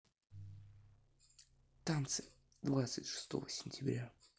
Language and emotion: Russian, neutral